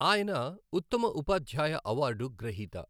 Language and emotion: Telugu, neutral